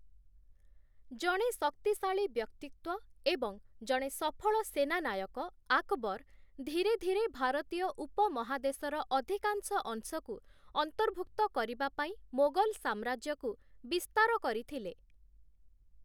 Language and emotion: Odia, neutral